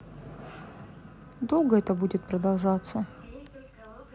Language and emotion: Russian, sad